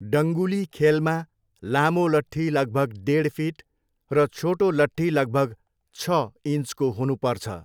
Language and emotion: Nepali, neutral